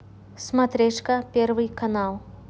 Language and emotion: Russian, neutral